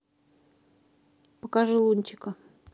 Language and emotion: Russian, neutral